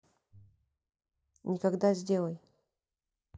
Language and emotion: Russian, neutral